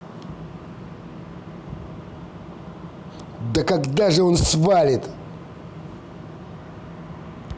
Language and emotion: Russian, angry